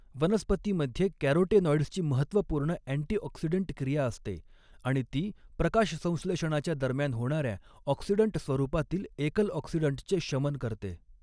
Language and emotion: Marathi, neutral